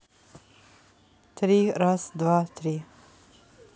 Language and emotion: Russian, neutral